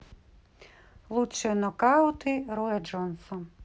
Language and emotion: Russian, neutral